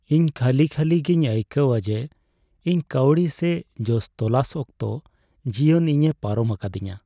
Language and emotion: Santali, sad